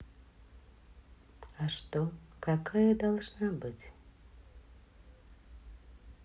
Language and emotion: Russian, sad